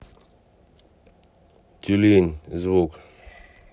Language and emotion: Russian, neutral